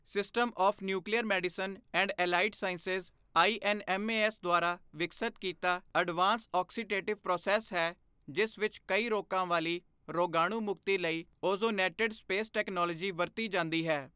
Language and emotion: Punjabi, neutral